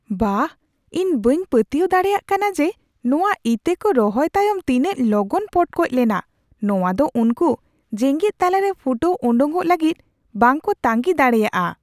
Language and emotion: Santali, surprised